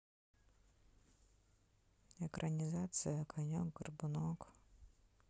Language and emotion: Russian, sad